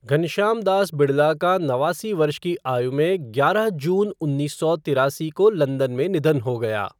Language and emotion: Hindi, neutral